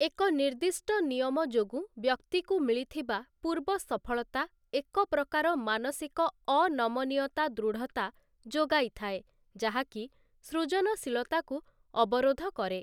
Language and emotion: Odia, neutral